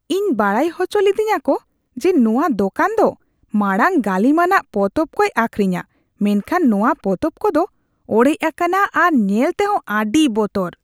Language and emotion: Santali, disgusted